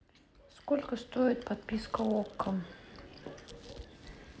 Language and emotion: Russian, neutral